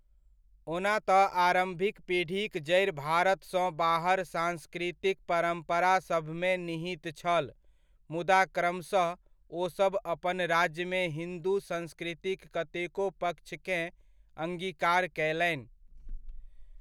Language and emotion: Maithili, neutral